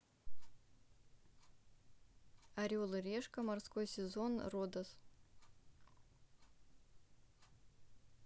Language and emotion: Russian, neutral